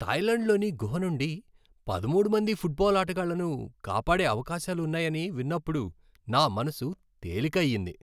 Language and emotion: Telugu, happy